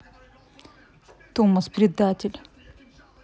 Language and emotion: Russian, angry